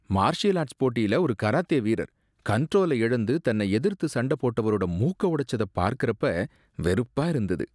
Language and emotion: Tamil, disgusted